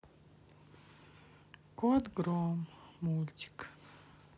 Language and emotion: Russian, sad